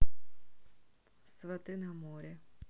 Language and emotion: Russian, neutral